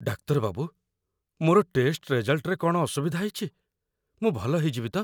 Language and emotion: Odia, fearful